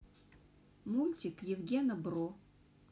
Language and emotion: Russian, neutral